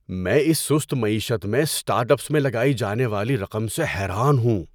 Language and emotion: Urdu, surprised